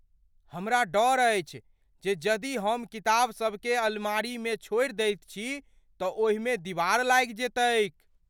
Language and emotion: Maithili, fearful